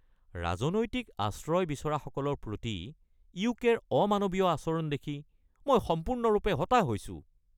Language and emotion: Assamese, angry